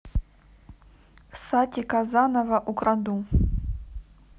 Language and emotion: Russian, neutral